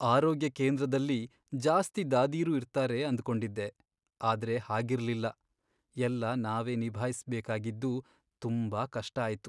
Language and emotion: Kannada, sad